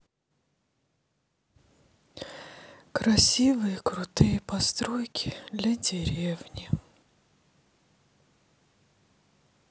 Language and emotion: Russian, sad